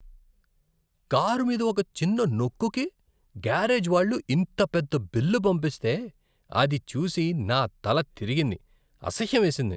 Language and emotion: Telugu, disgusted